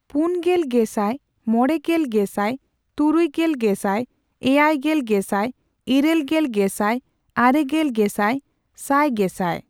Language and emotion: Santali, neutral